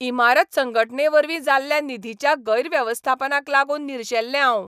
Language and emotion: Goan Konkani, angry